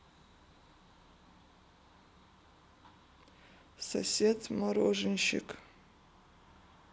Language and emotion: Russian, sad